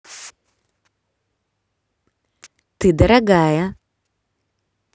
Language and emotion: Russian, positive